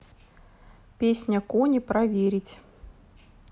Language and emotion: Russian, neutral